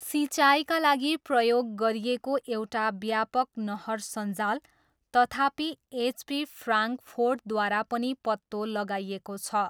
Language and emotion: Nepali, neutral